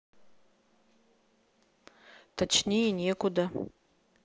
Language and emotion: Russian, neutral